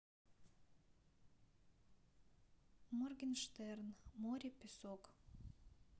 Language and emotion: Russian, neutral